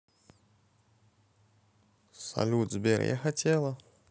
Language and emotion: Russian, neutral